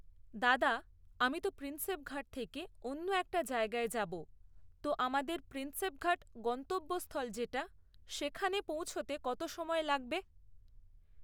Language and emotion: Bengali, neutral